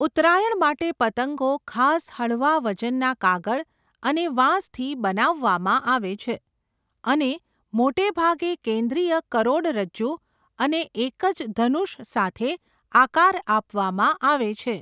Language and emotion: Gujarati, neutral